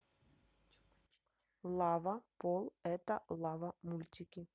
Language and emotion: Russian, neutral